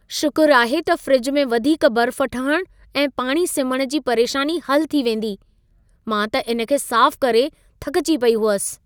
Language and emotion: Sindhi, happy